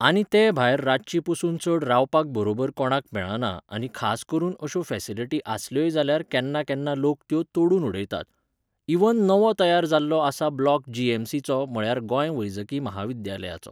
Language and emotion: Goan Konkani, neutral